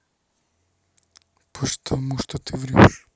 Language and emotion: Russian, neutral